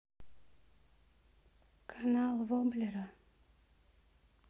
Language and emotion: Russian, sad